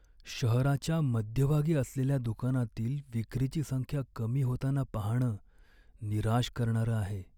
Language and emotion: Marathi, sad